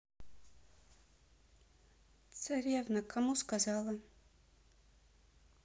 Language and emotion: Russian, sad